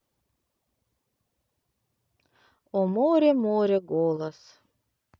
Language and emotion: Russian, neutral